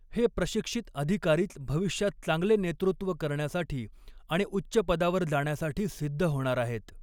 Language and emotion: Marathi, neutral